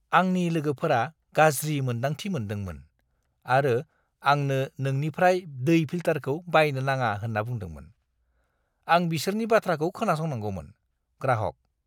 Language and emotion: Bodo, disgusted